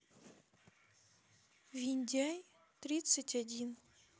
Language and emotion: Russian, sad